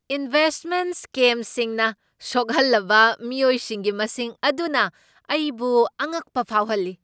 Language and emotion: Manipuri, surprised